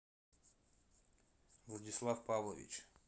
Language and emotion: Russian, neutral